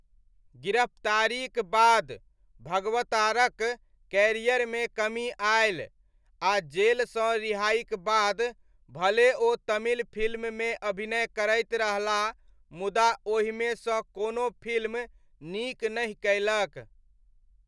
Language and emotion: Maithili, neutral